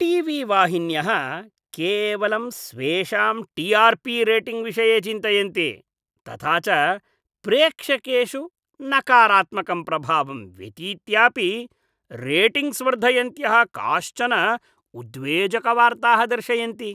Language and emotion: Sanskrit, disgusted